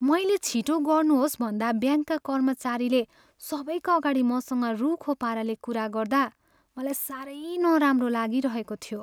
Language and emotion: Nepali, sad